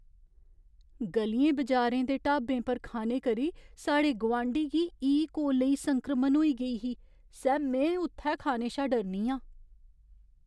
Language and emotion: Dogri, fearful